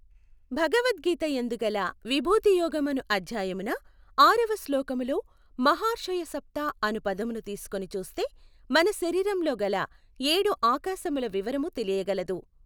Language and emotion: Telugu, neutral